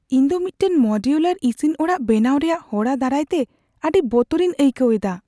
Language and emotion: Santali, fearful